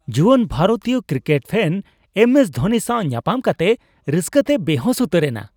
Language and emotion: Santali, happy